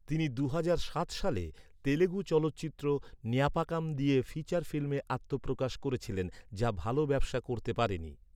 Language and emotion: Bengali, neutral